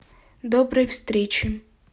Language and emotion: Russian, neutral